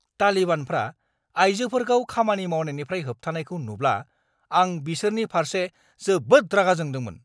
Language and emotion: Bodo, angry